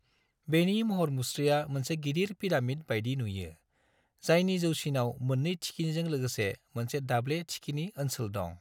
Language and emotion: Bodo, neutral